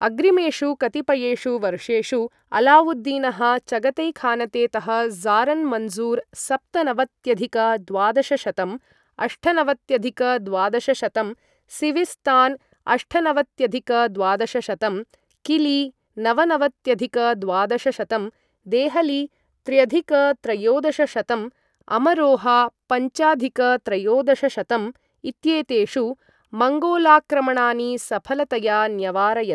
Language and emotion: Sanskrit, neutral